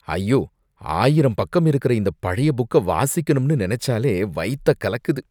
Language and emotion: Tamil, disgusted